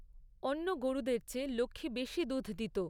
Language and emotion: Bengali, neutral